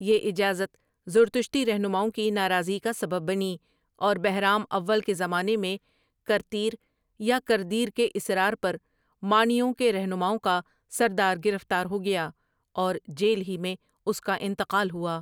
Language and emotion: Urdu, neutral